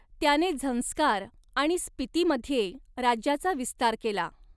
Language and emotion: Marathi, neutral